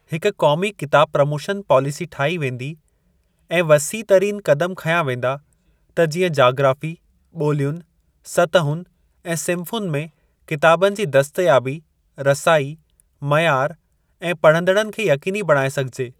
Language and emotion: Sindhi, neutral